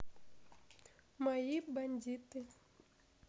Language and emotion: Russian, neutral